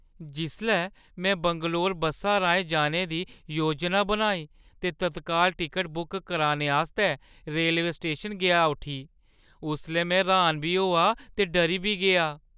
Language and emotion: Dogri, fearful